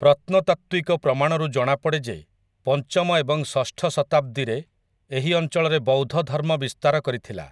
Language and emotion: Odia, neutral